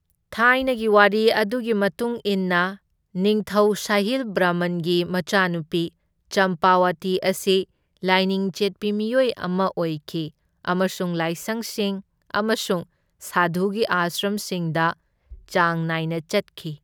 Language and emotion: Manipuri, neutral